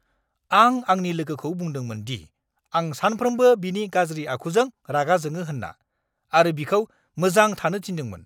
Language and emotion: Bodo, angry